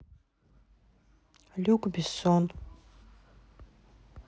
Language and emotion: Russian, neutral